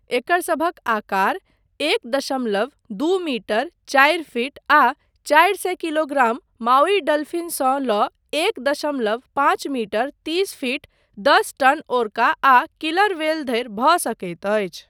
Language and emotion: Maithili, neutral